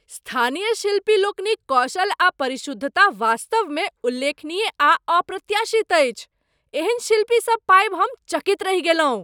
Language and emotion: Maithili, surprised